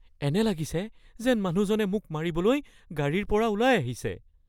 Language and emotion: Assamese, fearful